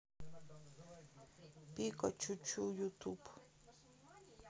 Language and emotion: Russian, sad